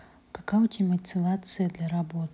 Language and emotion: Russian, neutral